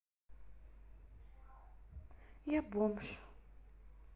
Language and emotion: Russian, sad